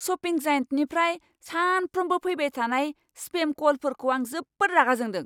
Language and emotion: Bodo, angry